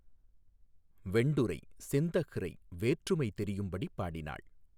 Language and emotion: Tamil, neutral